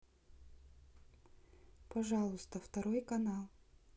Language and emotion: Russian, neutral